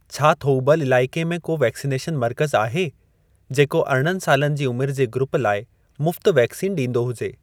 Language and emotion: Sindhi, neutral